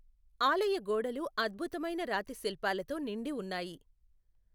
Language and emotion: Telugu, neutral